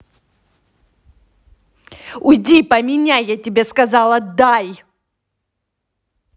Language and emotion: Russian, angry